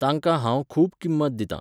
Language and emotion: Goan Konkani, neutral